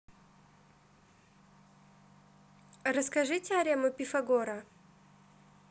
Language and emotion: Russian, neutral